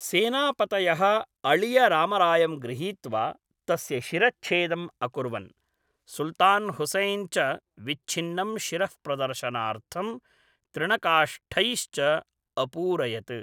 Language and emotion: Sanskrit, neutral